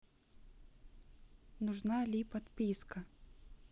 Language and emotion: Russian, neutral